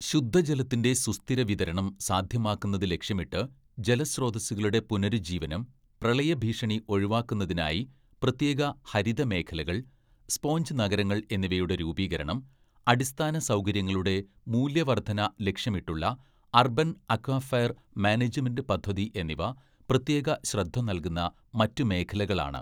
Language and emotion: Malayalam, neutral